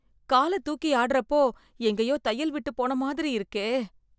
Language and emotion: Tamil, fearful